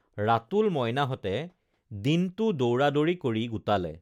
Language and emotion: Assamese, neutral